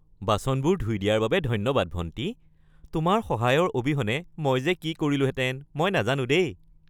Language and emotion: Assamese, happy